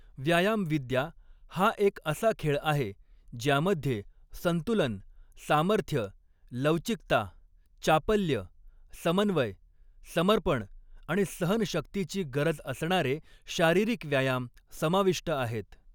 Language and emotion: Marathi, neutral